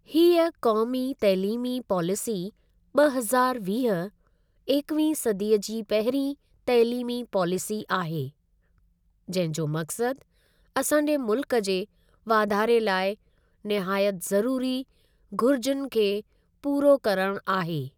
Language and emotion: Sindhi, neutral